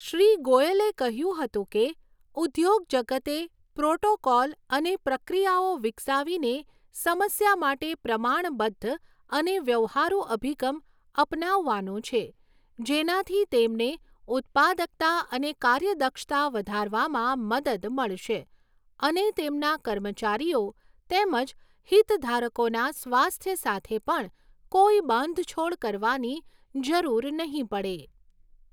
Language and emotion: Gujarati, neutral